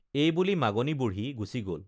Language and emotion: Assamese, neutral